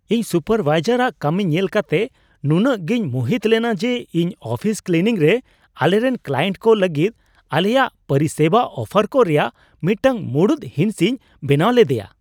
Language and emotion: Santali, surprised